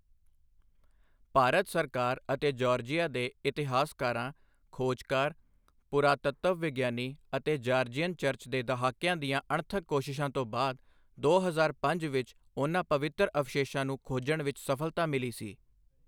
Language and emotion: Punjabi, neutral